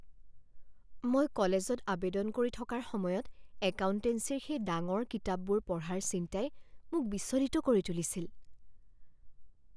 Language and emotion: Assamese, fearful